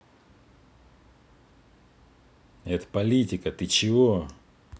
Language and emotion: Russian, angry